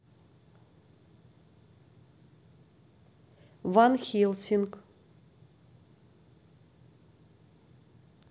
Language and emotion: Russian, neutral